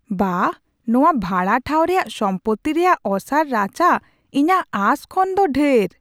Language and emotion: Santali, surprised